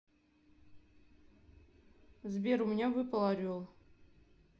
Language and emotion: Russian, neutral